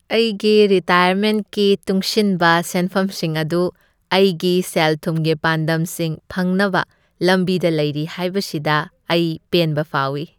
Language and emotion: Manipuri, happy